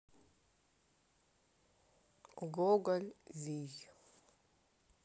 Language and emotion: Russian, neutral